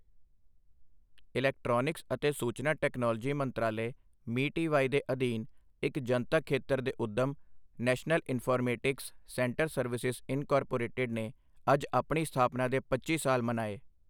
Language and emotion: Punjabi, neutral